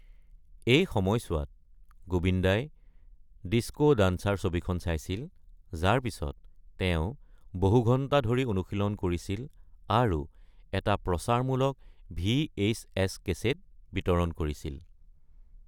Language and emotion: Assamese, neutral